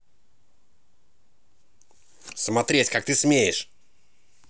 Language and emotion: Russian, angry